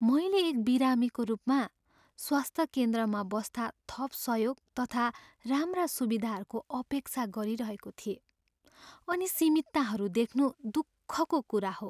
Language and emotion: Nepali, sad